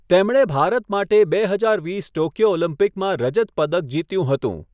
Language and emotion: Gujarati, neutral